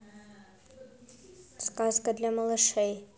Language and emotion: Russian, neutral